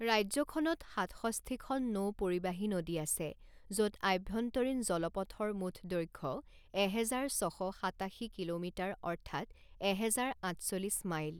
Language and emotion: Assamese, neutral